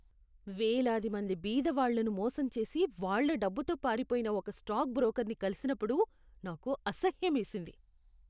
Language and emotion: Telugu, disgusted